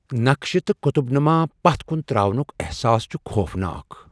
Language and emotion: Kashmiri, fearful